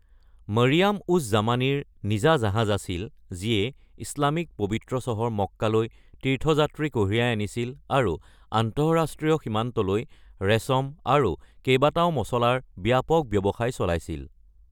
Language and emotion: Assamese, neutral